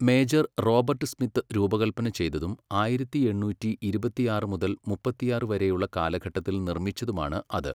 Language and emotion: Malayalam, neutral